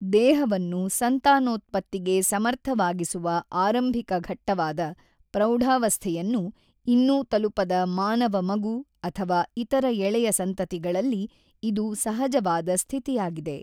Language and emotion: Kannada, neutral